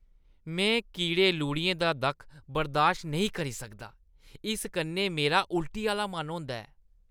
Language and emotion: Dogri, disgusted